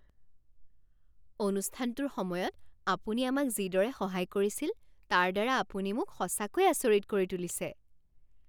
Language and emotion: Assamese, surprised